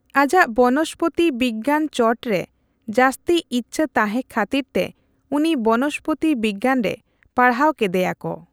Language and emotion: Santali, neutral